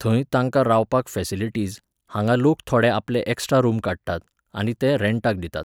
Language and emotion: Goan Konkani, neutral